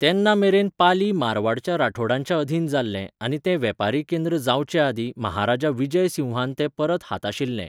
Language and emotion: Goan Konkani, neutral